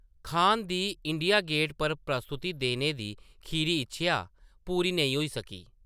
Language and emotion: Dogri, neutral